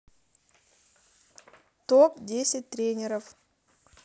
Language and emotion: Russian, neutral